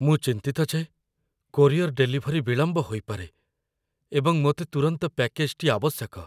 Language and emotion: Odia, fearful